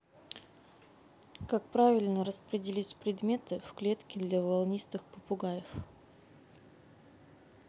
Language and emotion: Russian, neutral